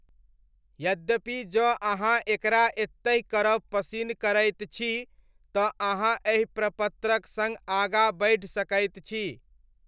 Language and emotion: Maithili, neutral